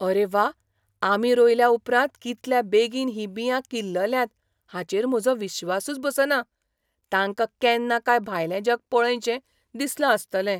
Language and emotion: Goan Konkani, surprised